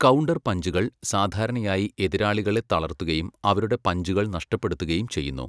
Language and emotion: Malayalam, neutral